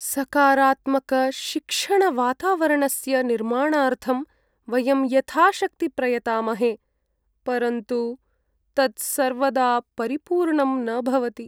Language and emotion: Sanskrit, sad